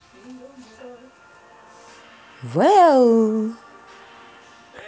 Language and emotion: Russian, positive